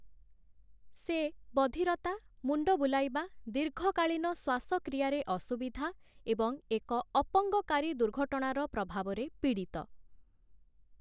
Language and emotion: Odia, neutral